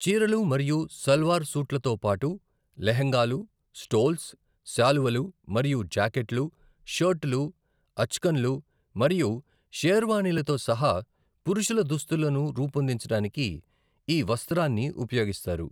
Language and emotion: Telugu, neutral